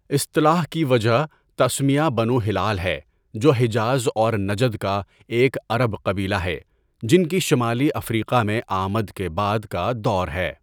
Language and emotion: Urdu, neutral